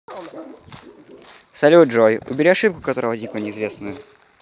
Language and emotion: Russian, neutral